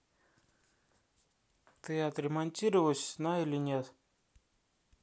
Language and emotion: Russian, neutral